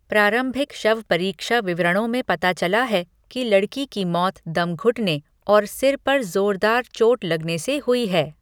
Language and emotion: Hindi, neutral